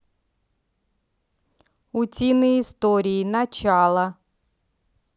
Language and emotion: Russian, neutral